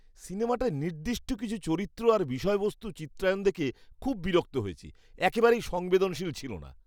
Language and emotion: Bengali, disgusted